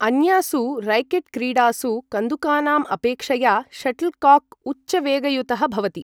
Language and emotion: Sanskrit, neutral